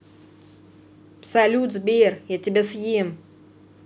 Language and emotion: Russian, positive